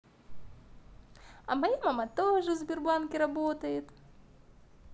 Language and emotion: Russian, positive